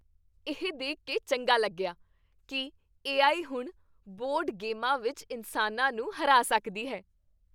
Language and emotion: Punjabi, happy